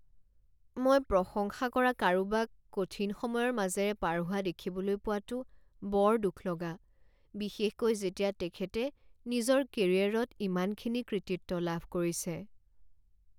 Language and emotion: Assamese, sad